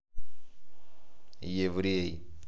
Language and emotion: Russian, neutral